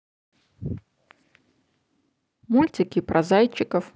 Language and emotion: Russian, positive